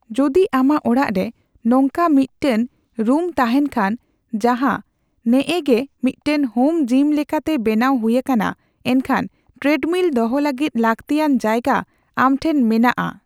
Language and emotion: Santali, neutral